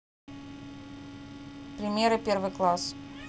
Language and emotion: Russian, neutral